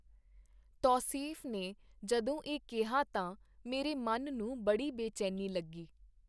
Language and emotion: Punjabi, neutral